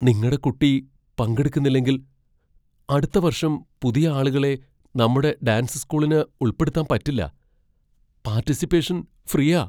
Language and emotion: Malayalam, fearful